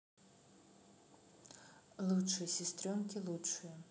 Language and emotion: Russian, neutral